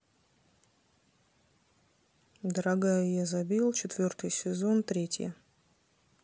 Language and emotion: Russian, neutral